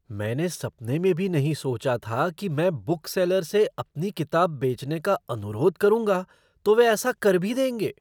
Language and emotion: Hindi, surprised